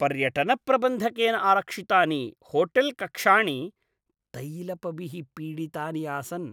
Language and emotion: Sanskrit, disgusted